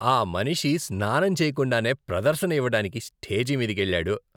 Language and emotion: Telugu, disgusted